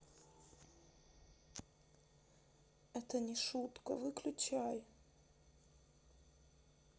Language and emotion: Russian, sad